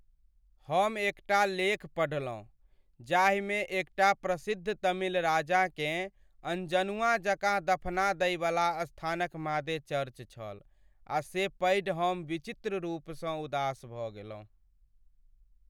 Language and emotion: Maithili, sad